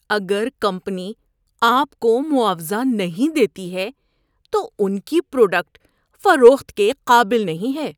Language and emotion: Urdu, disgusted